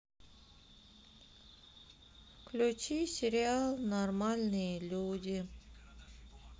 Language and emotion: Russian, sad